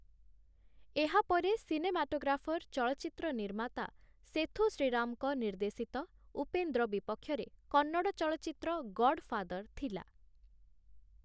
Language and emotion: Odia, neutral